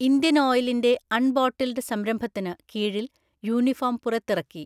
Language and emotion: Malayalam, neutral